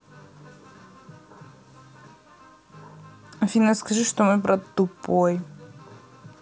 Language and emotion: Russian, neutral